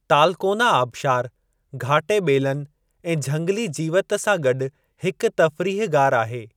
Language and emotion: Sindhi, neutral